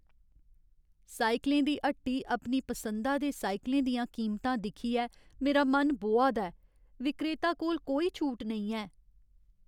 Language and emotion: Dogri, sad